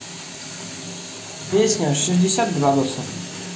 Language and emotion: Russian, neutral